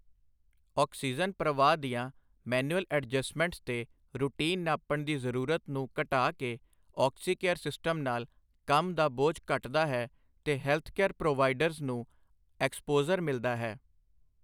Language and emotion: Punjabi, neutral